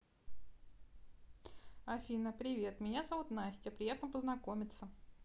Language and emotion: Russian, neutral